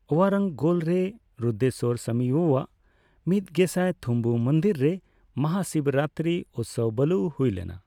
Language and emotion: Santali, neutral